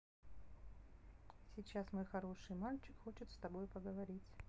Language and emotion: Russian, neutral